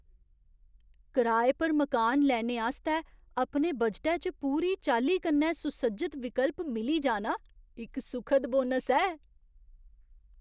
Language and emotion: Dogri, surprised